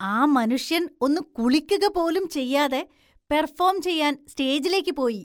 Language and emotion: Malayalam, disgusted